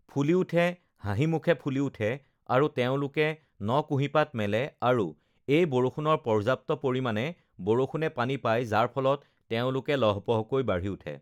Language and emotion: Assamese, neutral